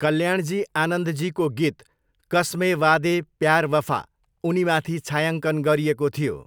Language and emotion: Nepali, neutral